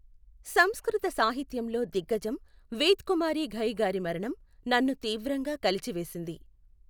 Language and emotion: Telugu, neutral